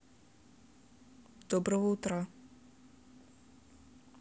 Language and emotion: Russian, neutral